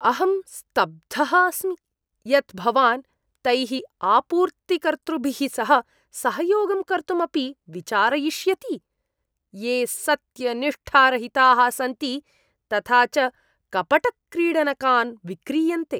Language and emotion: Sanskrit, disgusted